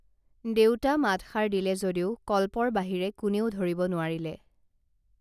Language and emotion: Assamese, neutral